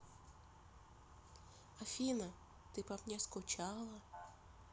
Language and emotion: Russian, neutral